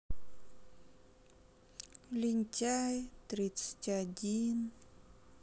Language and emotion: Russian, sad